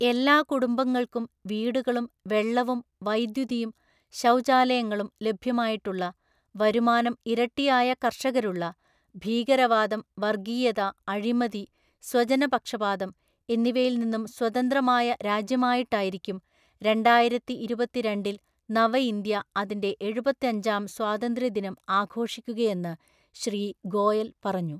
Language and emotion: Malayalam, neutral